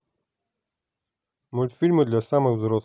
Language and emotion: Russian, neutral